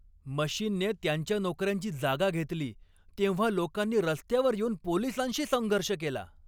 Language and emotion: Marathi, angry